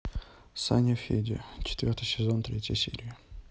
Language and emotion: Russian, neutral